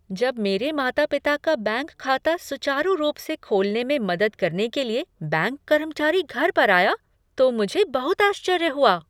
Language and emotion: Hindi, surprised